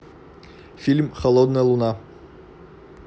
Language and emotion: Russian, neutral